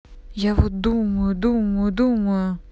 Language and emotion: Russian, angry